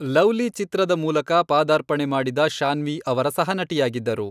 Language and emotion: Kannada, neutral